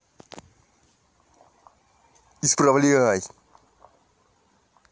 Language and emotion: Russian, angry